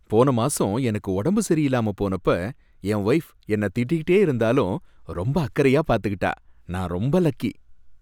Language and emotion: Tamil, happy